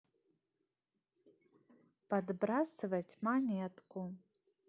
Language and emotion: Russian, positive